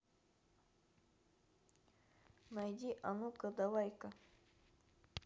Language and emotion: Russian, neutral